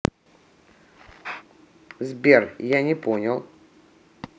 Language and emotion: Russian, neutral